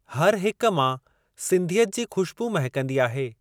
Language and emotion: Sindhi, neutral